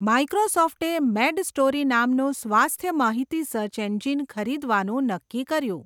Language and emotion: Gujarati, neutral